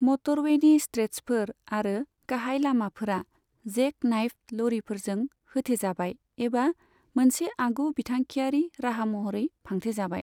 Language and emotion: Bodo, neutral